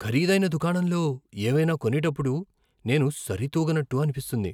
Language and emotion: Telugu, fearful